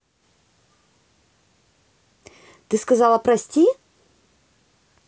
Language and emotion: Russian, positive